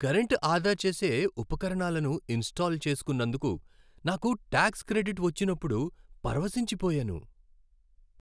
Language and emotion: Telugu, happy